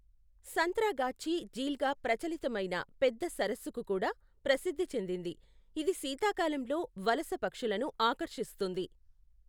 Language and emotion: Telugu, neutral